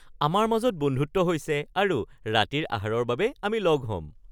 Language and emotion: Assamese, happy